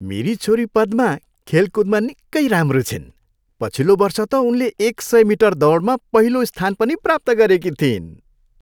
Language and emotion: Nepali, happy